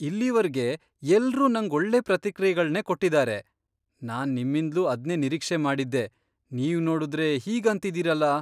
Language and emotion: Kannada, surprised